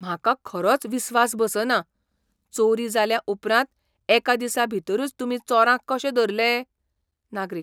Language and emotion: Goan Konkani, surprised